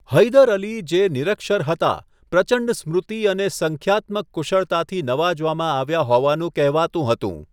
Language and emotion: Gujarati, neutral